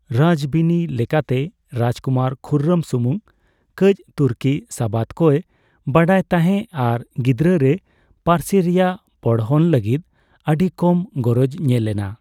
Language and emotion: Santali, neutral